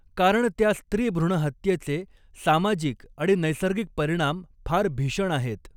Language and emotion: Marathi, neutral